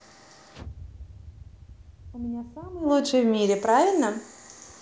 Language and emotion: Russian, positive